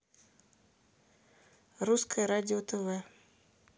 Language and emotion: Russian, neutral